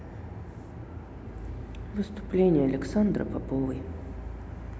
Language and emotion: Russian, sad